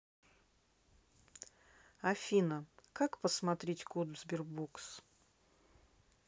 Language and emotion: Russian, neutral